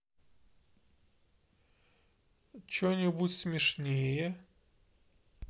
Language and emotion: Russian, neutral